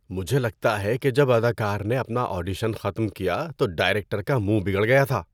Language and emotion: Urdu, disgusted